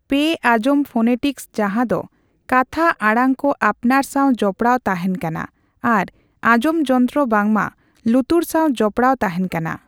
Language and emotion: Santali, neutral